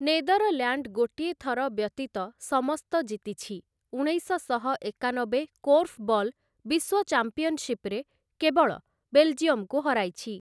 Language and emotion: Odia, neutral